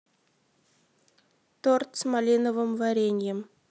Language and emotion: Russian, neutral